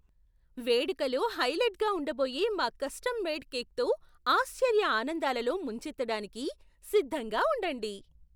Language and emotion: Telugu, surprised